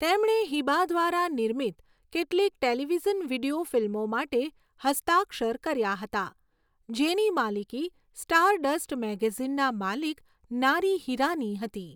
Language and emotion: Gujarati, neutral